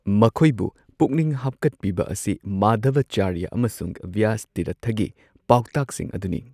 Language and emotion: Manipuri, neutral